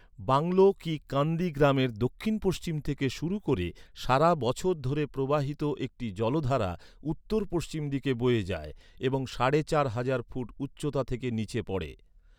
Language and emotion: Bengali, neutral